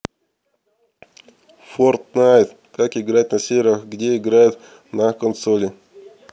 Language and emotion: Russian, neutral